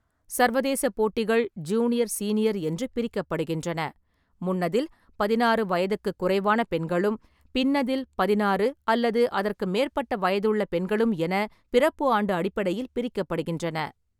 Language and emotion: Tamil, neutral